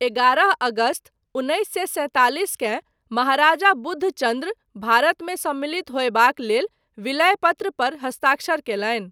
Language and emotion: Maithili, neutral